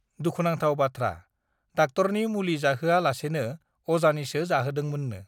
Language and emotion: Bodo, neutral